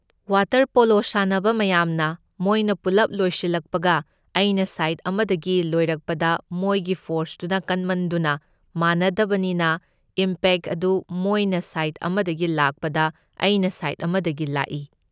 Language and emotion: Manipuri, neutral